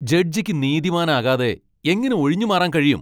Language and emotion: Malayalam, angry